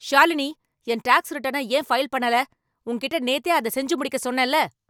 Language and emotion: Tamil, angry